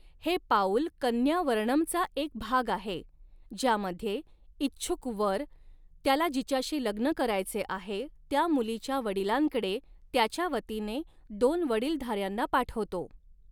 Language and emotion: Marathi, neutral